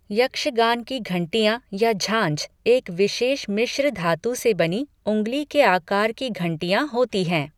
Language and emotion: Hindi, neutral